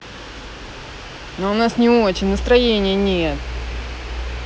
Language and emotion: Russian, angry